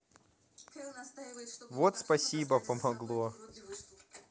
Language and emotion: Russian, positive